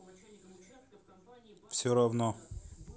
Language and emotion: Russian, neutral